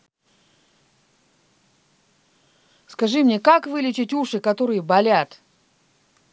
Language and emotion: Russian, angry